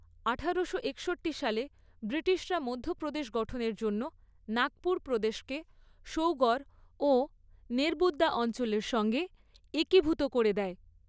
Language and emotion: Bengali, neutral